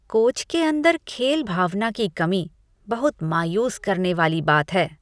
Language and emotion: Hindi, disgusted